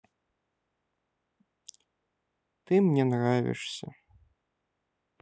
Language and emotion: Russian, sad